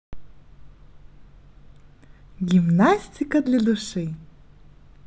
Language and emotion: Russian, positive